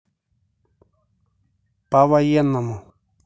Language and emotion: Russian, neutral